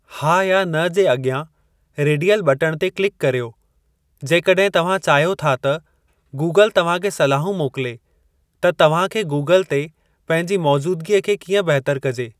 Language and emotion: Sindhi, neutral